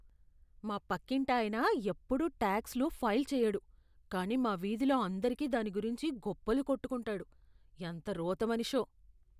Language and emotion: Telugu, disgusted